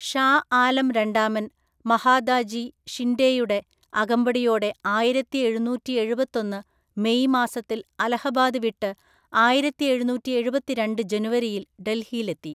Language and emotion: Malayalam, neutral